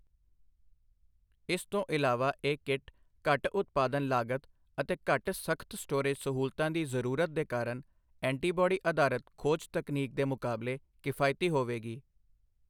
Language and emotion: Punjabi, neutral